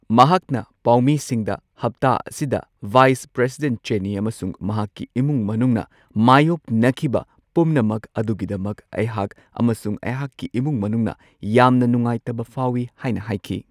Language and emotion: Manipuri, neutral